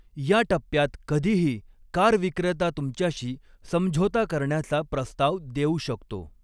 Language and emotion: Marathi, neutral